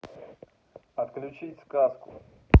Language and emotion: Russian, neutral